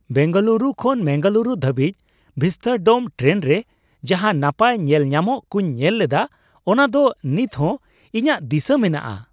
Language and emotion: Santali, happy